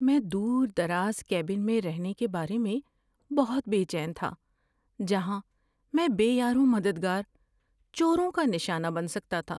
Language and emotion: Urdu, fearful